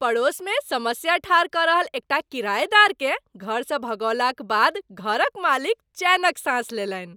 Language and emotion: Maithili, happy